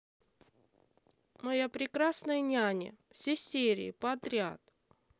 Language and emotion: Russian, neutral